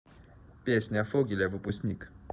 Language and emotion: Russian, neutral